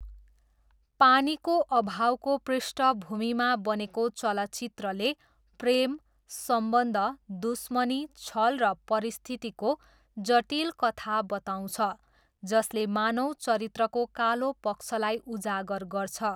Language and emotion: Nepali, neutral